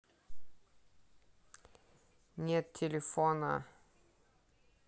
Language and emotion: Russian, neutral